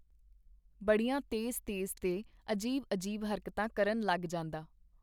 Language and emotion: Punjabi, neutral